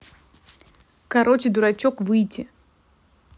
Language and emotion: Russian, angry